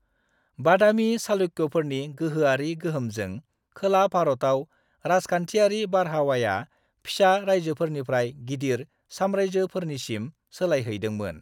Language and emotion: Bodo, neutral